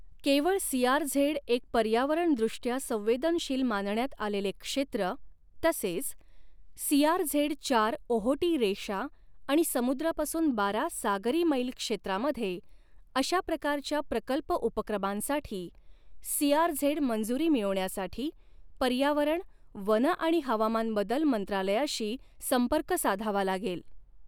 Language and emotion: Marathi, neutral